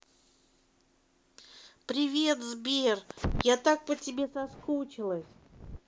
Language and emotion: Russian, positive